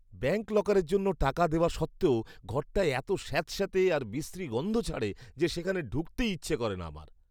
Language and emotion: Bengali, disgusted